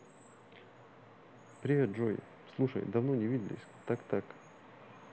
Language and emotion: Russian, neutral